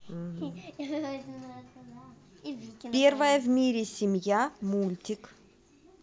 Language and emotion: Russian, neutral